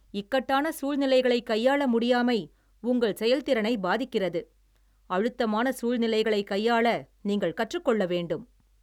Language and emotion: Tamil, angry